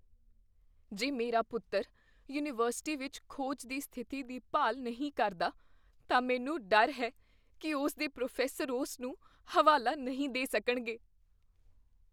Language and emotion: Punjabi, fearful